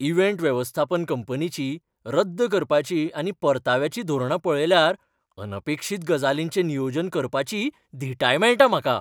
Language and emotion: Goan Konkani, happy